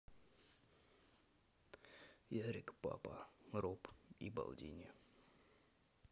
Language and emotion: Russian, neutral